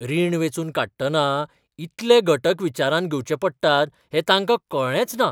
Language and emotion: Goan Konkani, surprised